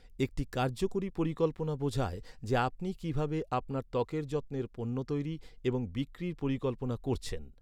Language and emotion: Bengali, neutral